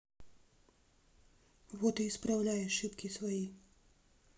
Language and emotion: Russian, neutral